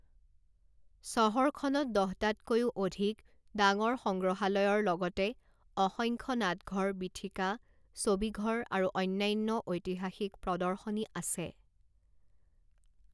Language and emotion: Assamese, neutral